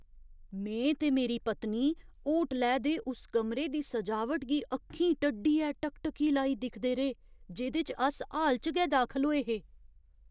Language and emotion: Dogri, surprised